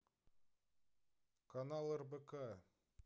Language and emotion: Russian, neutral